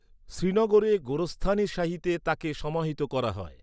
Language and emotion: Bengali, neutral